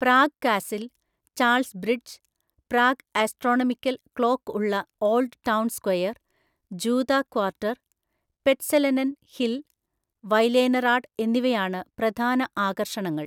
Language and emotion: Malayalam, neutral